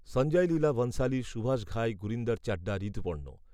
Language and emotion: Bengali, neutral